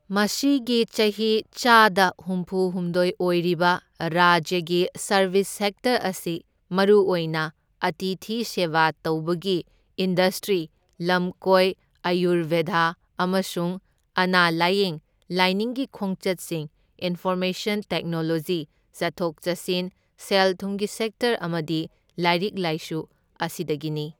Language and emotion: Manipuri, neutral